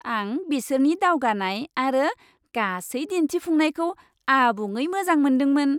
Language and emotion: Bodo, happy